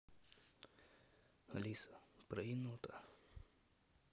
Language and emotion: Russian, neutral